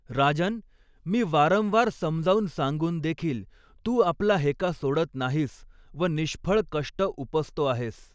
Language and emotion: Marathi, neutral